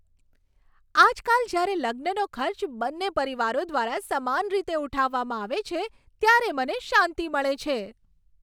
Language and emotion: Gujarati, happy